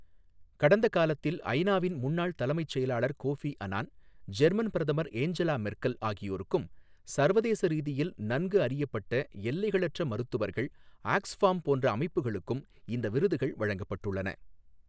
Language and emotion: Tamil, neutral